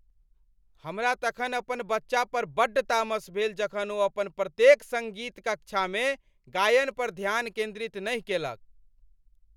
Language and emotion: Maithili, angry